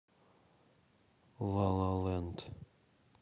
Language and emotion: Russian, neutral